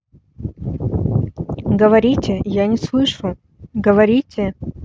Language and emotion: Russian, neutral